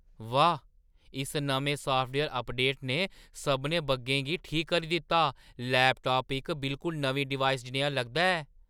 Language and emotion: Dogri, surprised